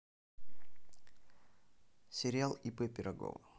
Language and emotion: Russian, neutral